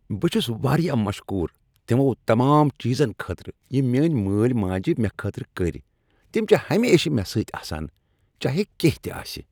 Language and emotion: Kashmiri, happy